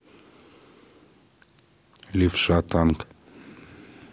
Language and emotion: Russian, neutral